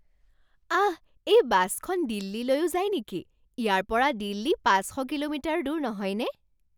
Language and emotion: Assamese, surprised